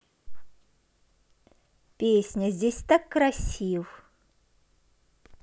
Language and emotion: Russian, positive